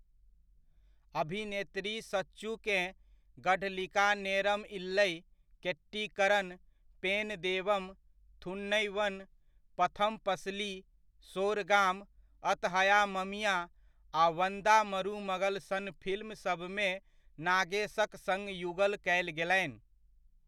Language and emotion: Maithili, neutral